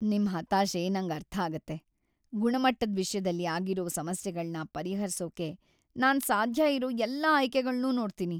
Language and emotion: Kannada, sad